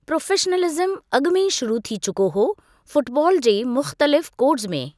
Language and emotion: Sindhi, neutral